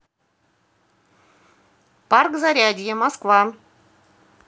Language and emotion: Russian, positive